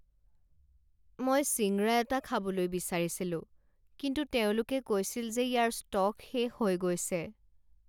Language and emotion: Assamese, sad